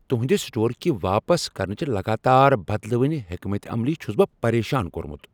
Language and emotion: Kashmiri, angry